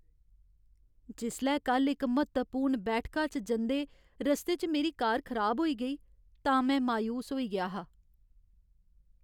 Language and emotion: Dogri, sad